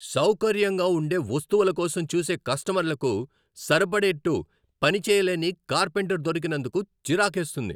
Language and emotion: Telugu, angry